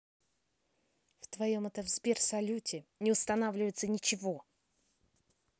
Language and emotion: Russian, angry